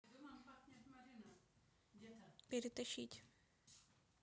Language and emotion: Russian, neutral